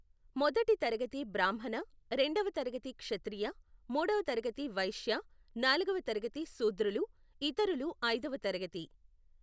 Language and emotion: Telugu, neutral